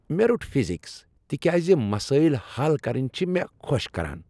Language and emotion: Kashmiri, happy